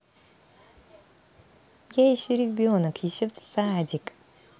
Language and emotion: Russian, positive